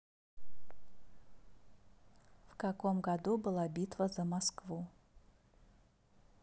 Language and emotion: Russian, neutral